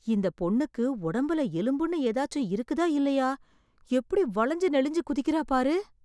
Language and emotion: Tamil, surprised